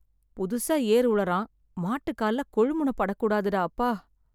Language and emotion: Tamil, sad